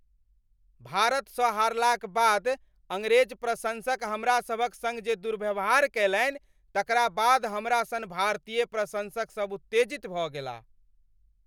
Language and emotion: Maithili, angry